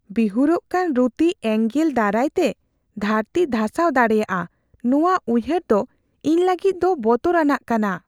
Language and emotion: Santali, fearful